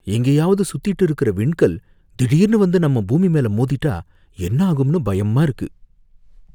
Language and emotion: Tamil, fearful